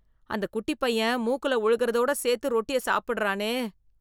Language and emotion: Tamil, disgusted